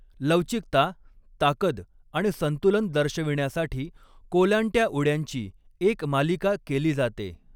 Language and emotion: Marathi, neutral